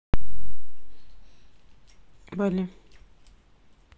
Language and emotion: Russian, neutral